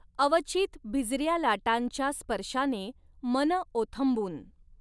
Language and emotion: Marathi, neutral